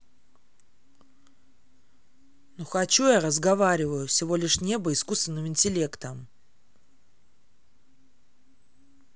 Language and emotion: Russian, angry